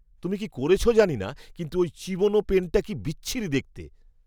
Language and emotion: Bengali, disgusted